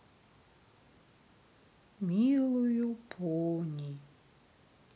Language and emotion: Russian, sad